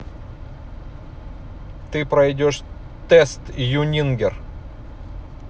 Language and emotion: Russian, neutral